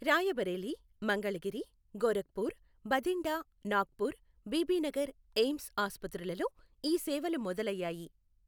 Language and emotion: Telugu, neutral